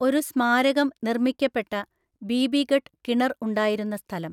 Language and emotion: Malayalam, neutral